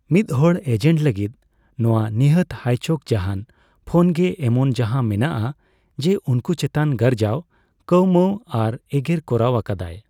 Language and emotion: Santali, neutral